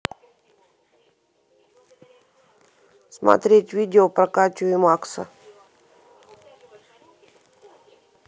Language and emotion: Russian, neutral